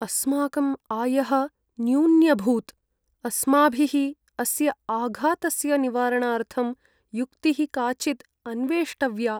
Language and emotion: Sanskrit, sad